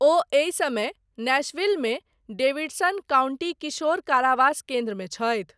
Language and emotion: Maithili, neutral